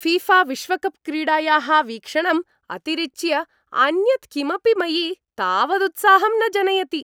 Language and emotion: Sanskrit, happy